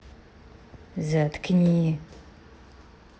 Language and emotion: Russian, angry